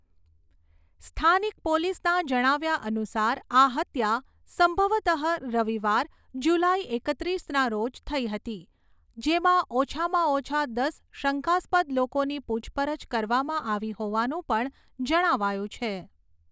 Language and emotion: Gujarati, neutral